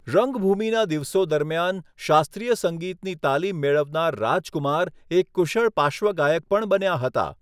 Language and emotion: Gujarati, neutral